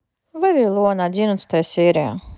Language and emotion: Russian, neutral